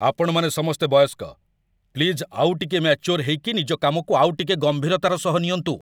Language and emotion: Odia, angry